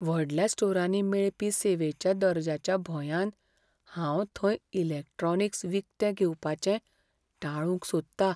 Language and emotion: Goan Konkani, fearful